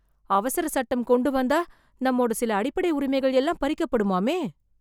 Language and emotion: Tamil, fearful